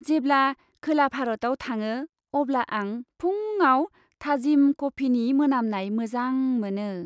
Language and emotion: Bodo, happy